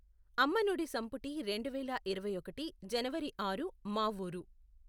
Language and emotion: Telugu, neutral